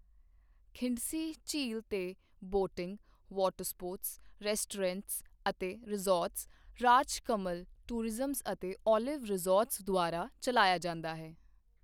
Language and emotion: Punjabi, neutral